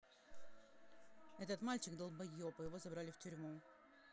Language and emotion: Russian, angry